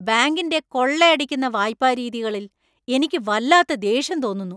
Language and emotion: Malayalam, angry